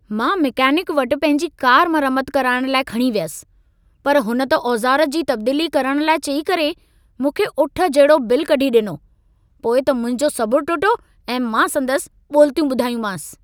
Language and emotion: Sindhi, angry